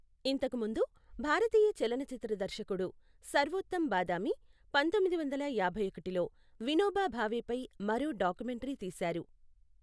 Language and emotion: Telugu, neutral